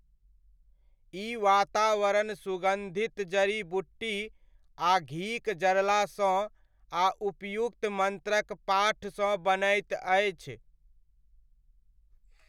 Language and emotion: Maithili, neutral